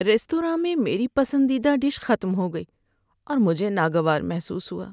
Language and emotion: Urdu, sad